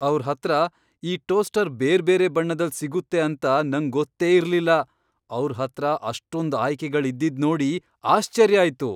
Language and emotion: Kannada, surprised